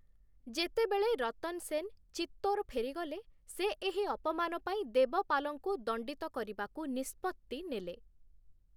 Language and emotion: Odia, neutral